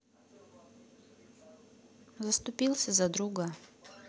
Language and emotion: Russian, neutral